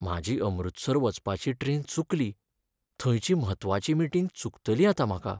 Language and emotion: Goan Konkani, sad